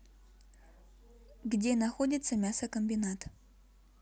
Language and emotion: Russian, neutral